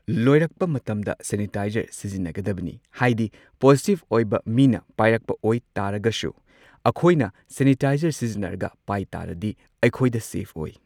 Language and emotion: Manipuri, neutral